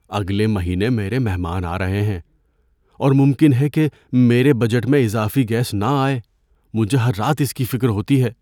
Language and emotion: Urdu, fearful